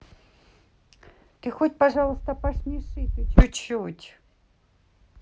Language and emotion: Russian, neutral